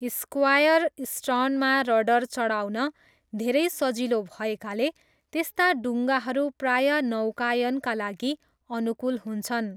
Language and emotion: Nepali, neutral